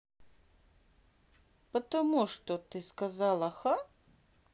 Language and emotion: Russian, neutral